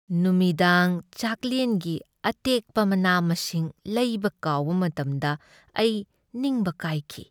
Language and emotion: Manipuri, sad